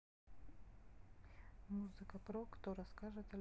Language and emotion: Russian, neutral